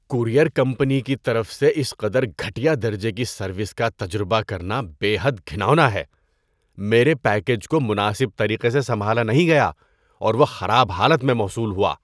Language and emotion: Urdu, disgusted